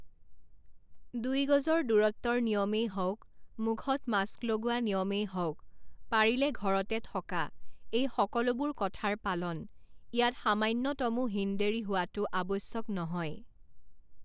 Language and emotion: Assamese, neutral